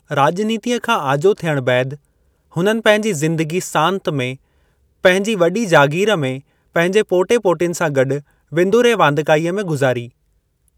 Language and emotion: Sindhi, neutral